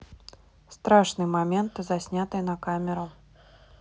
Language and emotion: Russian, neutral